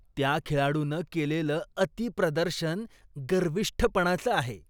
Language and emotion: Marathi, disgusted